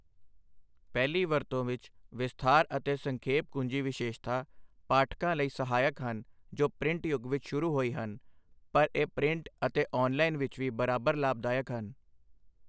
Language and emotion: Punjabi, neutral